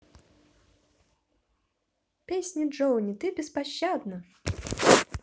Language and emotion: Russian, positive